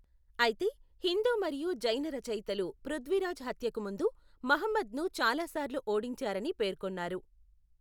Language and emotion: Telugu, neutral